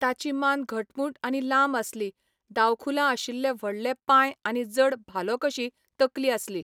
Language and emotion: Goan Konkani, neutral